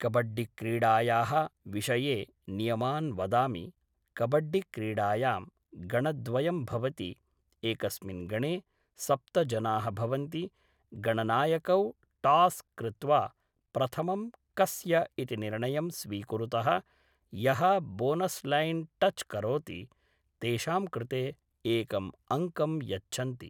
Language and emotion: Sanskrit, neutral